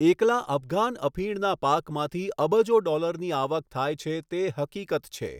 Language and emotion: Gujarati, neutral